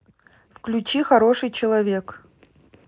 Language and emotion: Russian, neutral